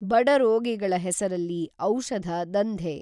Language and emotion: Kannada, neutral